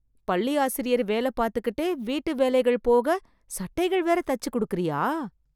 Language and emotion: Tamil, surprised